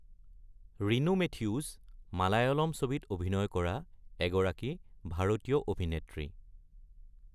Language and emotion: Assamese, neutral